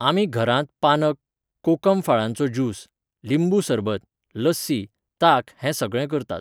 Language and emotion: Goan Konkani, neutral